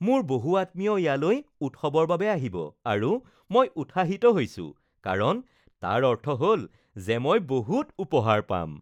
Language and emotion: Assamese, happy